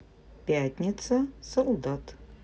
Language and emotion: Russian, neutral